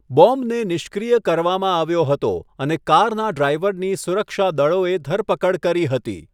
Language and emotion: Gujarati, neutral